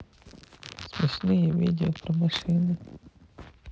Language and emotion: Russian, sad